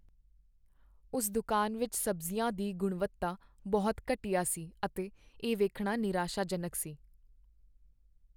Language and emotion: Punjabi, sad